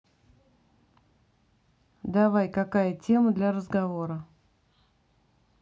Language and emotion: Russian, neutral